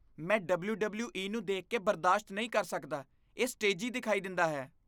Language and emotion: Punjabi, disgusted